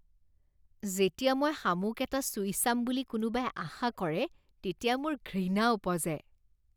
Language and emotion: Assamese, disgusted